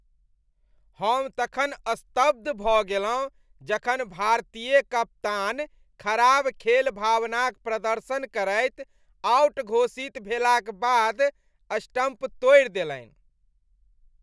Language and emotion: Maithili, disgusted